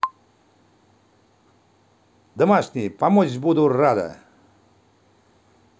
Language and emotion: Russian, positive